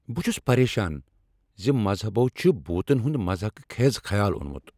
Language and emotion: Kashmiri, angry